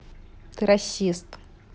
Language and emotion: Russian, neutral